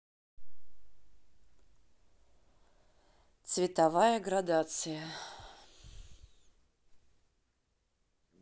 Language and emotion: Russian, neutral